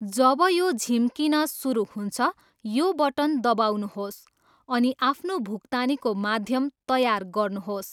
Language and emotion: Nepali, neutral